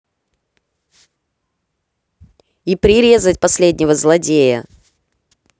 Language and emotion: Russian, angry